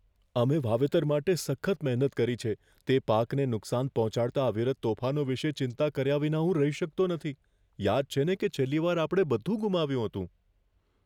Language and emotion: Gujarati, fearful